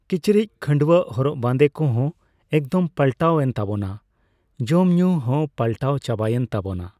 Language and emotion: Santali, neutral